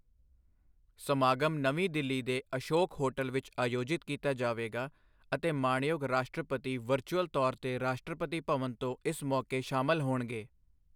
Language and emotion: Punjabi, neutral